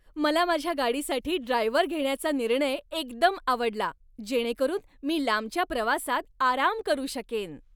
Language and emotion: Marathi, happy